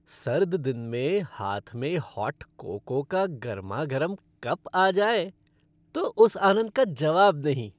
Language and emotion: Hindi, happy